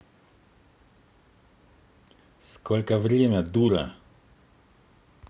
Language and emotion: Russian, angry